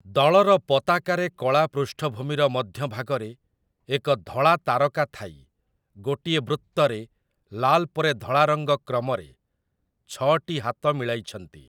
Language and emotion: Odia, neutral